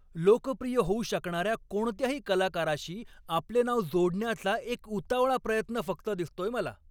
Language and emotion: Marathi, angry